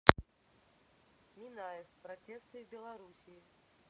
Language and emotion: Russian, neutral